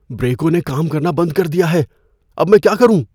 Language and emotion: Urdu, fearful